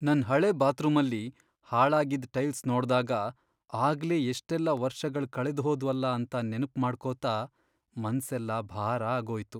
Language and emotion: Kannada, sad